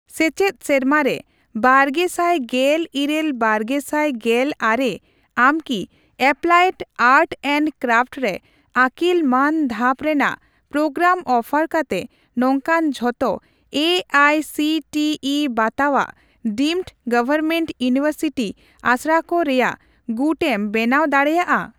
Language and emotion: Santali, neutral